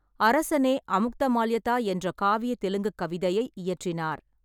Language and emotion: Tamil, neutral